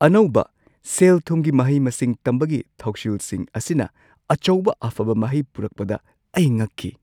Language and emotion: Manipuri, surprised